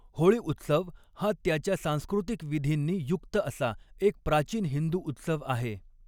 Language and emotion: Marathi, neutral